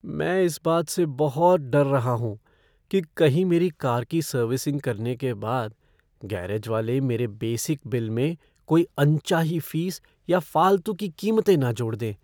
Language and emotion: Hindi, fearful